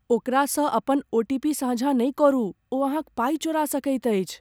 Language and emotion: Maithili, fearful